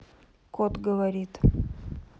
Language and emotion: Russian, neutral